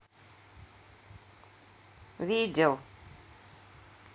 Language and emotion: Russian, neutral